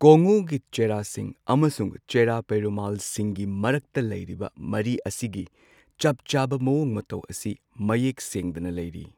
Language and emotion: Manipuri, neutral